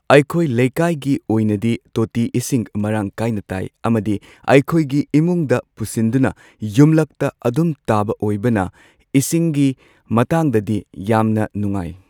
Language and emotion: Manipuri, neutral